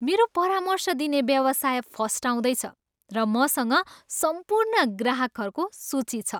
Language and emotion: Nepali, happy